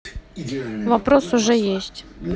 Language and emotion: Russian, neutral